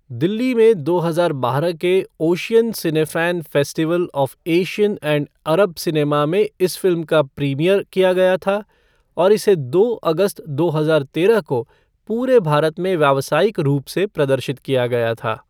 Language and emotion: Hindi, neutral